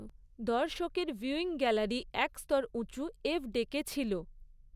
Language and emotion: Bengali, neutral